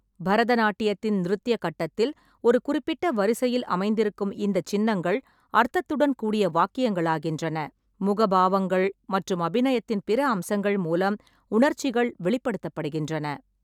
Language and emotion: Tamil, neutral